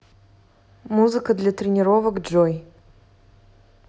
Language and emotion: Russian, neutral